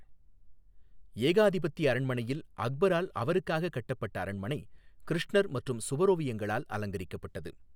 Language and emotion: Tamil, neutral